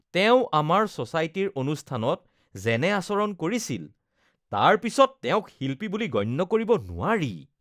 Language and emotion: Assamese, disgusted